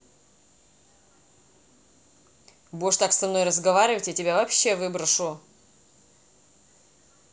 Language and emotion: Russian, angry